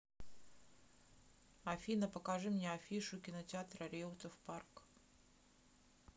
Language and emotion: Russian, neutral